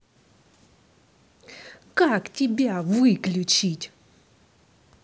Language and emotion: Russian, angry